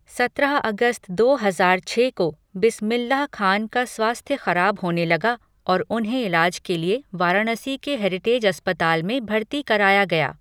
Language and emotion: Hindi, neutral